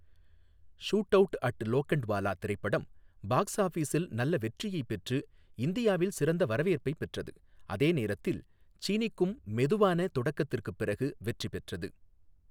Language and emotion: Tamil, neutral